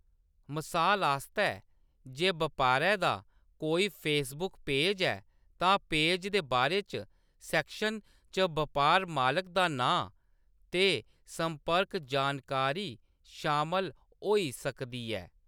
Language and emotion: Dogri, neutral